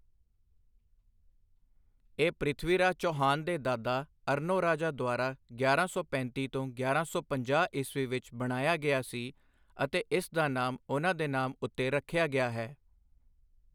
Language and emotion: Punjabi, neutral